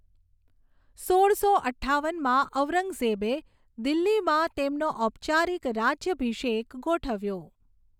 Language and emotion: Gujarati, neutral